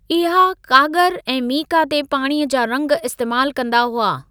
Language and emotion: Sindhi, neutral